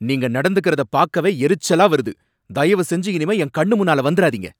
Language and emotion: Tamil, angry